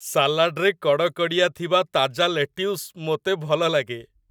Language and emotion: Odia, happy